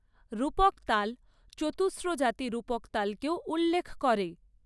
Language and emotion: Bengali, neutral